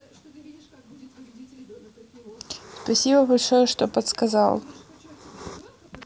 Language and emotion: Russian, neutral